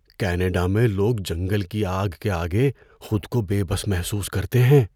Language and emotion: Urdu, fearful